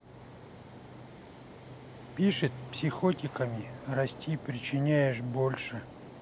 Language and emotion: Russian, neutral